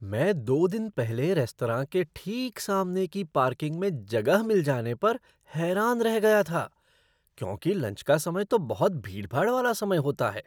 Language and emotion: Hindi, surprised